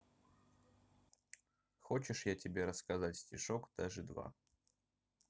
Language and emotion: Russian, neutral